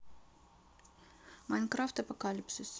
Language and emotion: Russian, neutral